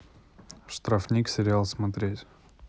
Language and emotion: Russian, neutral